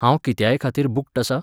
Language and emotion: Goan Konkani, neutral